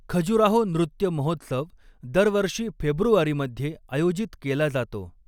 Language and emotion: Marathi, neutral